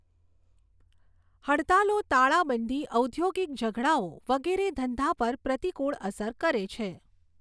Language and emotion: Gujarati, neutral